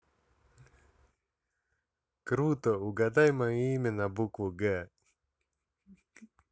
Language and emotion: Russian, positive